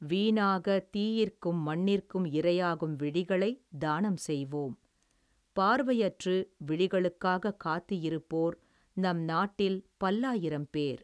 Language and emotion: Tamil, neutral